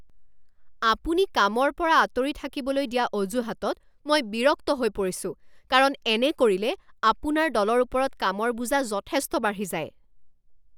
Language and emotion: Assamese, angry